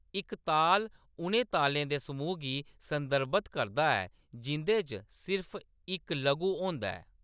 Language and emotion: Dogri, neutral